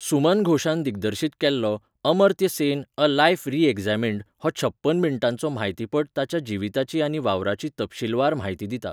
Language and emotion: Goan Konkani, neutral